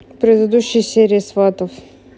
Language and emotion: Russian, neutral